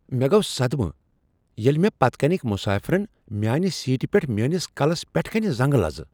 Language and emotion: Kashmiri, surprised